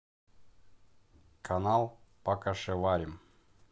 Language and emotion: Russian, neutral